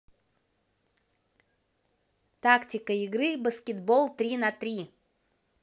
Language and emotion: Russian, positive